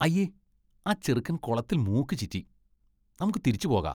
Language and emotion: Malayalam, disgusted